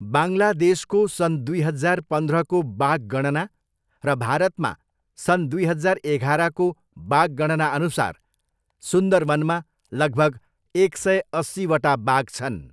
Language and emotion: Nepali, neutral